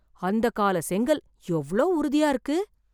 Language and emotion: Tamil, surprised